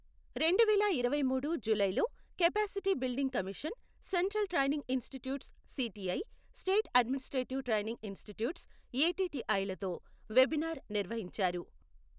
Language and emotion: Telugu, neutral